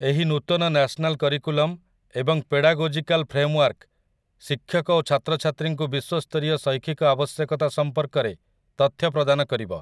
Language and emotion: Odia, neutral